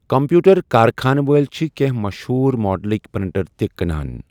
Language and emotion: Kashmiri, neutral